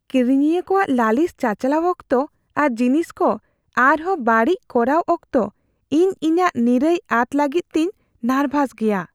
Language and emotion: Santali, fearful